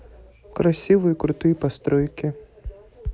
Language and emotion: Russian, neutral